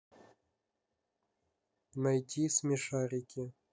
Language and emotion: Russian, neutral